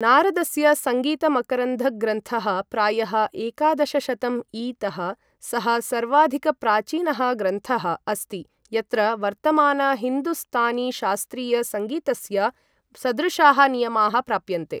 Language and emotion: Sanskrit, neutral